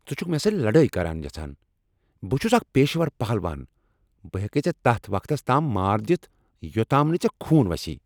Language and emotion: Kashmiri, angry